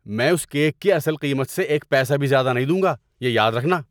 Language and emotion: Urdu, angry